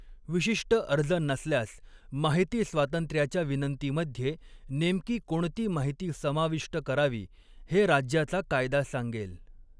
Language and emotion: Marathi, neutral